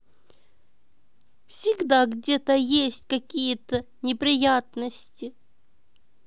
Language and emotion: Russian, neutral